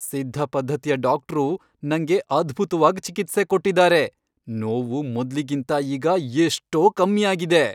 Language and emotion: Kannada, happy